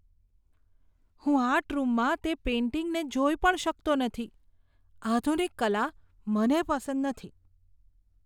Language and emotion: Gujarati, disgusted